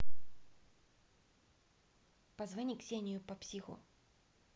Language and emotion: Russian, neutral